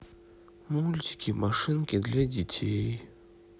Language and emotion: Russian, sad